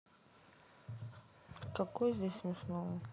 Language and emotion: Russian, sad